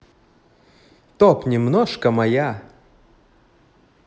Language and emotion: Russian, positive